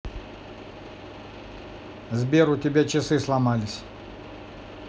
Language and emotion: Russian, neutral